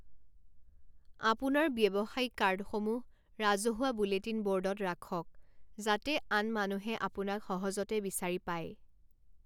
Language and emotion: Assamese, neutral